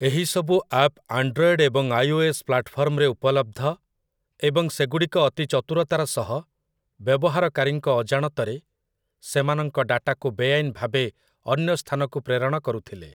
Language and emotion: Odia, neutral